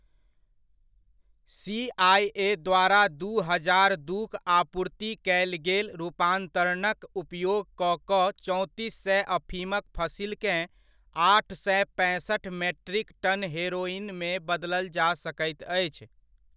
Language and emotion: Maithili, neutral